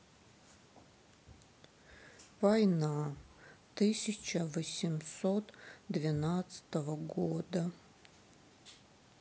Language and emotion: Russian, sad